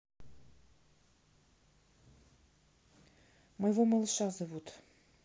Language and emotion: Russian, neutral